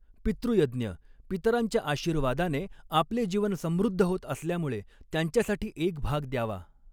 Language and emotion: Marathi, neutral